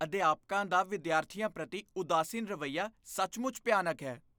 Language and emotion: Punjabi, disgusted